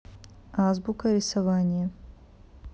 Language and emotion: Russian, neutral